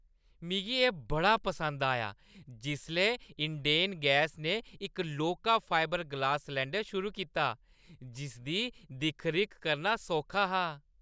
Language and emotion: Dogri, happy